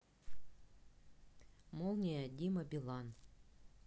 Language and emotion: Russian, neutral